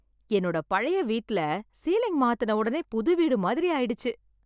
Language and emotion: Tamil, happy